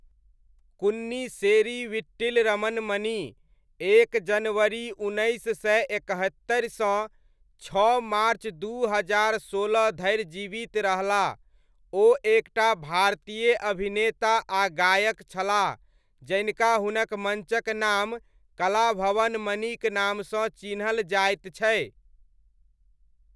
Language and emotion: Maithili, neutral